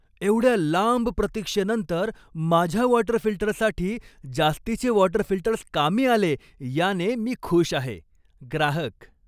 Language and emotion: Marathi, happy